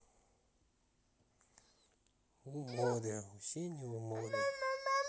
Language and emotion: Russian, sad